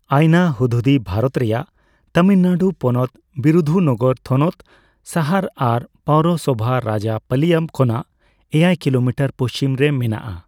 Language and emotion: Santali, neutral